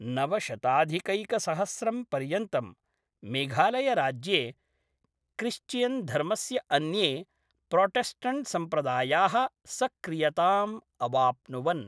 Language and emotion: Sanskrit, neutral